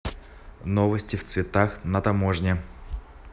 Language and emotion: Russian, neutral